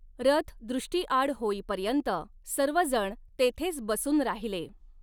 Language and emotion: Marathi, neutral